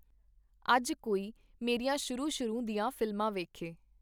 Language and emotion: Punjabi, neutral